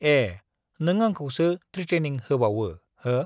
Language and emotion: Bodo, neutral